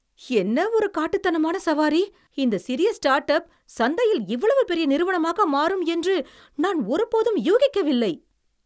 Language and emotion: Tamil, surprised